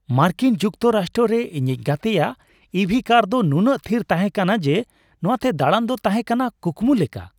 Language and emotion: Santali, happy